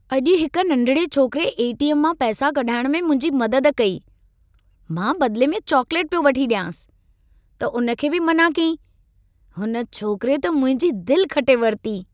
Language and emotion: Sindhi, happy